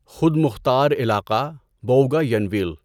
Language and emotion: Urdu, neutral